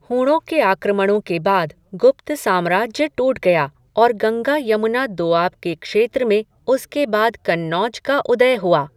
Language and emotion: Hindi, neutral